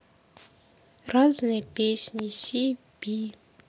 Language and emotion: Russian, sad